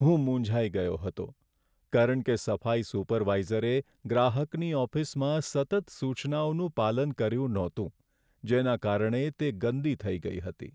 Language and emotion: Gujarati, sad